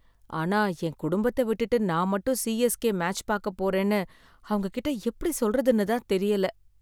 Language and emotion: Tamil, sad